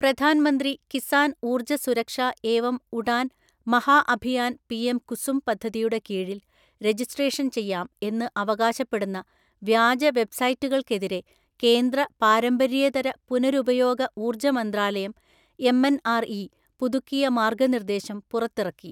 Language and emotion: Malayalam, neutral